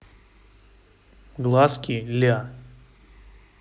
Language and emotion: Russian, neutral